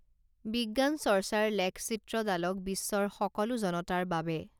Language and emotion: Assamese, neutral